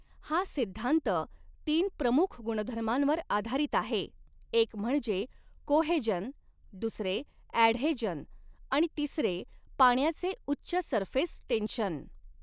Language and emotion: Marathi, neutral